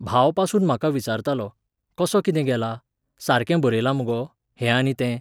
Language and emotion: Goan Konkani, neutral